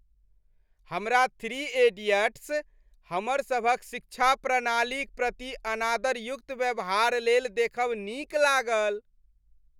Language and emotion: Maithili, happy